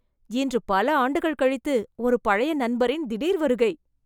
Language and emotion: Tamil, surprised